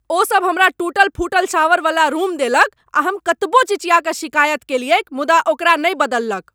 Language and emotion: Maithili, angry